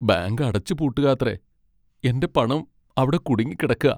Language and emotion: Malayalam, sad